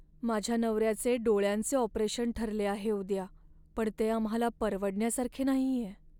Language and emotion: Marathi, sad